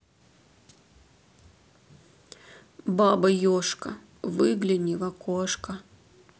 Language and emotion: Russian, sad